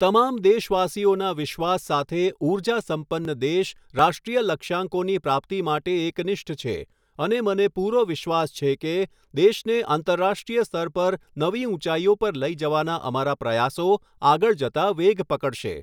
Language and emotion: Gujarati, neutral